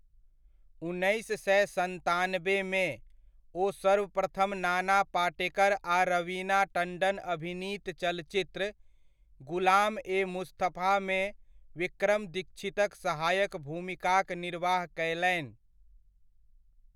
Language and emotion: Maithili, neutral